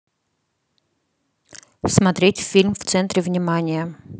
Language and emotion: Russian, neutral